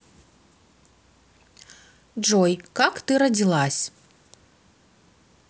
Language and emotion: Russian, neutral